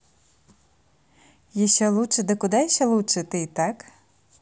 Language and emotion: Russian, positive